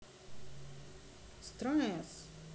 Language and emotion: Russian, neutral